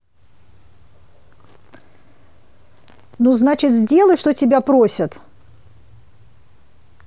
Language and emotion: Russian, angry